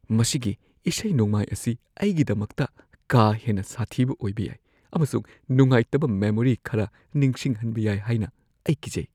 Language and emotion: Manipuri, fearful